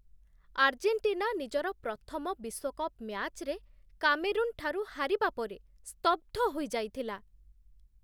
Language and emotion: Odia, surprised